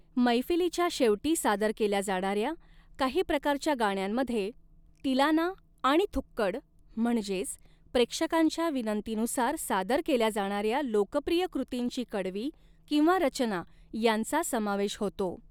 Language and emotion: Marathi, neutral